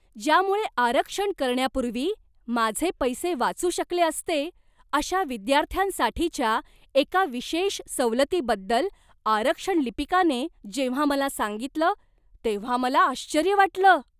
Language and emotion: Marathi, surprised